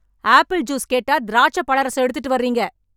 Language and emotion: Tamil, angry